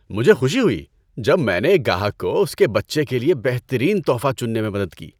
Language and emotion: Urdu, happy